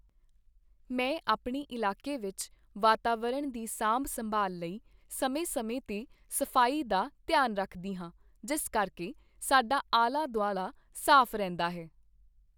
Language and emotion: Punjabi, neutral